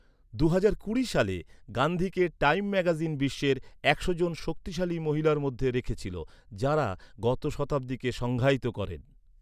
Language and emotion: Bengali, neutral